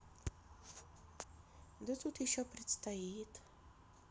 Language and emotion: Russian, neutral